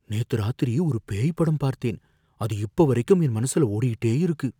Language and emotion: Tamil, fearful